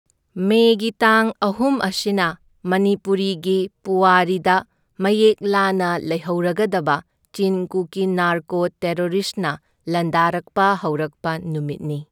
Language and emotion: Manipuri, neutral